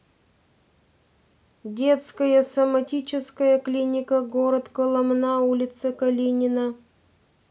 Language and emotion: Russian, neutral